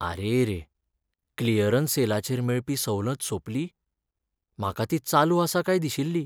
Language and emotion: Goan Konkani, sad